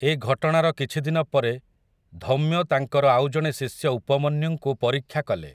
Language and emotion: Odia, neutral